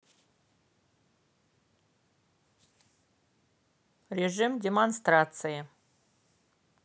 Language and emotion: Russian, neutral